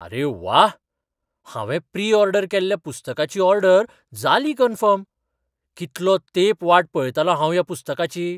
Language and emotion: Goan Konkani, surprised